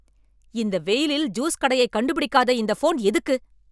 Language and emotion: Tamil, angry